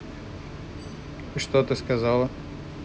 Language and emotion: Russian, neutral